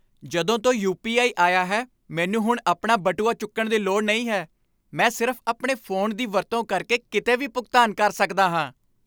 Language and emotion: Punjabi, happy